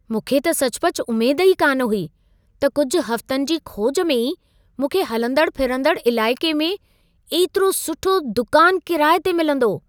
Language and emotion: Sindhi, surprised